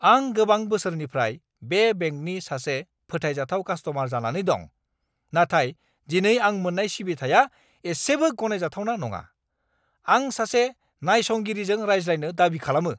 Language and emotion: Bodo, angry